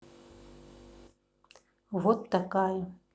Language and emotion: Russian, neutral